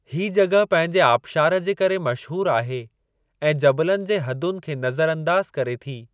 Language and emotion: Sindhi, neutral